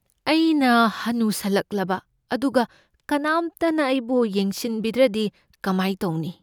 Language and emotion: Manipuri, fearful